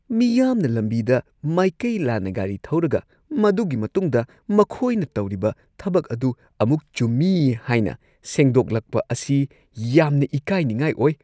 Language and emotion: Manipuri, disgusted